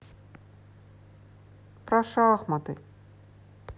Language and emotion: Russian, sad